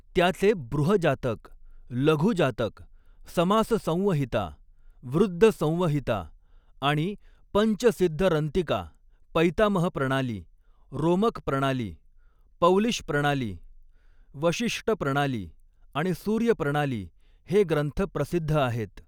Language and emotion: Marathi, neutral